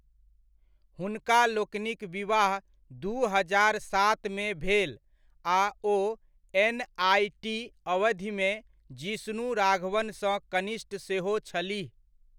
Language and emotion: Maithili, neutral